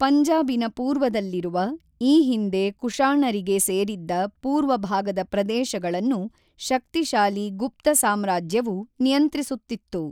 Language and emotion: Kannada, neutral